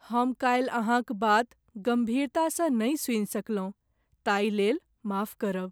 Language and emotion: Maithili, sad